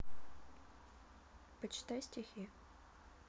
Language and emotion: Russian, neutral